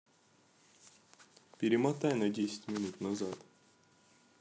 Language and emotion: Russian, neutral